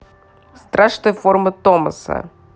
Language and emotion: Russian, neutral